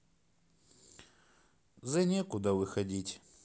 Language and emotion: Russian, sad